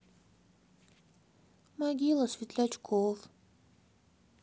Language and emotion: Russian, sad